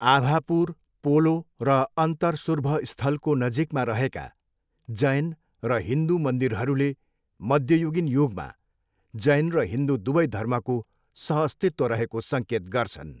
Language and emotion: Nepali, neutral